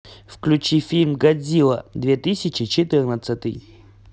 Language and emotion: Russian, neutral